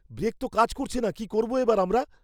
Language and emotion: Bengali, fearful